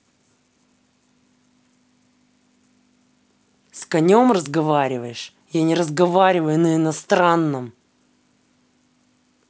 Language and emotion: Russian, angry